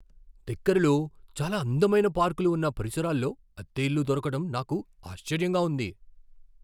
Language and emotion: Telugu, surprised